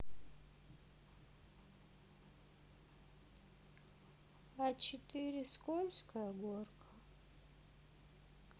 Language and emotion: Russian, sad